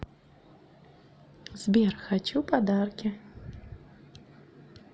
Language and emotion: Russian, positive